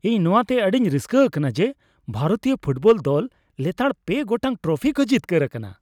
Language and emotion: Santali, happy